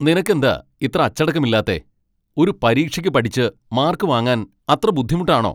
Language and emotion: Malayalam, angry